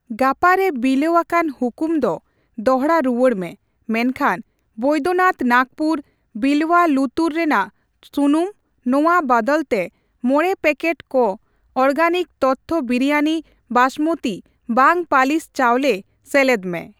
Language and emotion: Santali, neutral